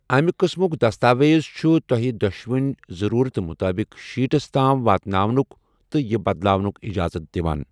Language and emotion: Kashmiri, neutral